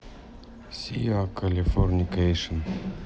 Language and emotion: Russian, neutral